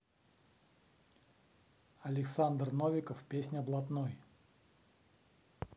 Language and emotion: Russian, neutral